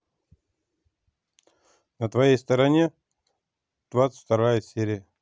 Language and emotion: Russian, neutral